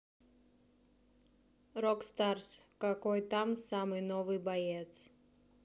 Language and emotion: Russian, neutral